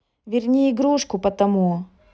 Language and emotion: Russian, neutral